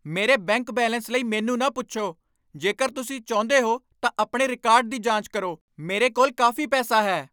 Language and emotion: Punjabi, angry